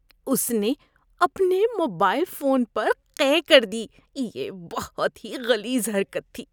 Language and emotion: Urdu, disgusted